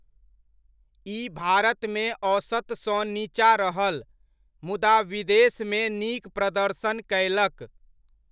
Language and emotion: Maithili, neutral